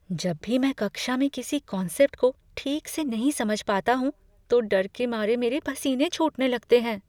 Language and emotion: Hindi, fearful